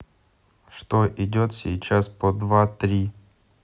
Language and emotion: Russian, neutral